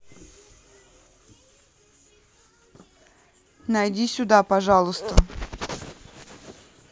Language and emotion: Russian, neutral